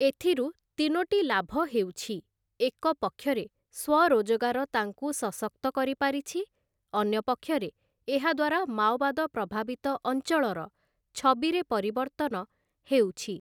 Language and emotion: Odia, neutral